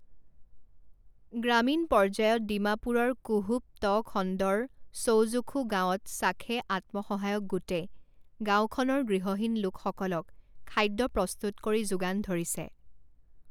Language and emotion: Assamese, neutral